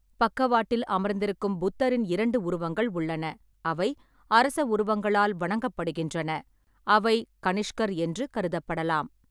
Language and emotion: Tamil, neutral